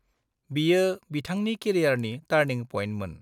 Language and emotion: Bodo, neutral